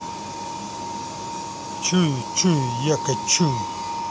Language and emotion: Russian, angry